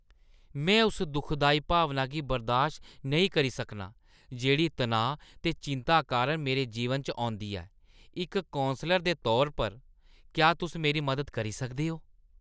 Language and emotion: Dogri, disgusted